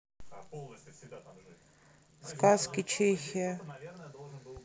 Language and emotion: Russian, neutral